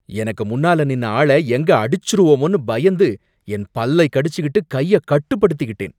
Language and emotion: Tamil, angry